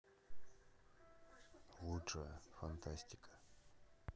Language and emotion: Russian, neutral